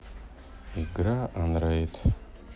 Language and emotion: Russian, sad